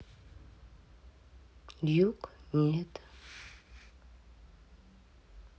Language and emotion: Russian, sad